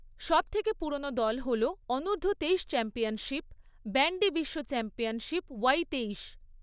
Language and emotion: Bengali, neutral